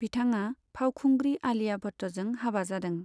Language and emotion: Bodo, neutral